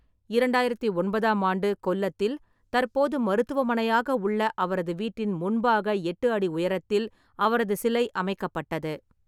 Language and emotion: Tamil, neutral